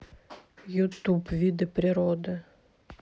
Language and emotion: Russian, neutral